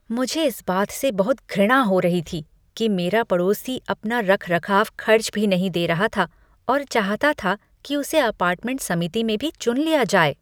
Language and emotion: Hindi, disgusted